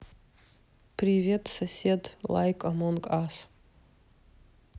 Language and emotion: Russian, neutral